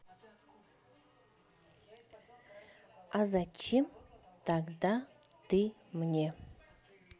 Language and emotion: Russian, neutral